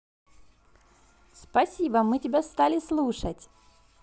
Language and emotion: Russian, positive